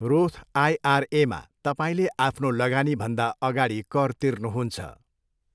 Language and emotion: Nepali, neutral